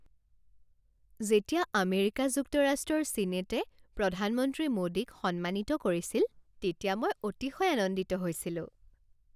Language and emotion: Assamese, happy